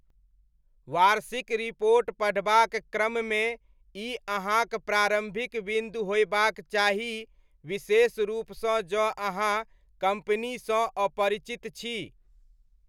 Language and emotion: Maithili, neutral